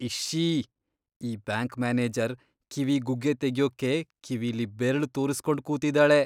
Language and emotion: Kannada, disgusted